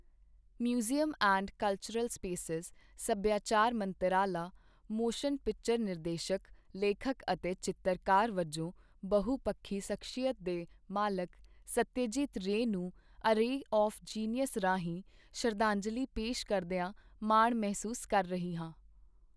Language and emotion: Punjabi, neutral